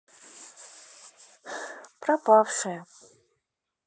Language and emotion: Russian, sad